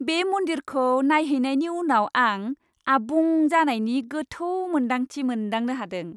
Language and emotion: Bodo, happy